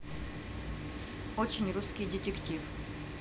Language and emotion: Russian, neutral